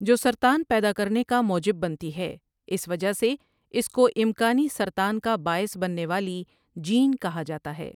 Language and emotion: Urdu, neutral